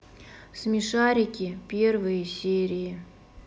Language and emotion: Russian, neutral